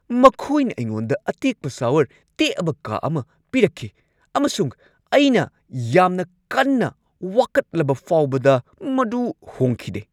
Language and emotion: Manipuri, angry